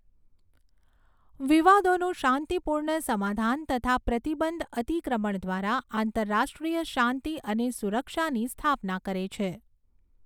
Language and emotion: Gujarati, neutral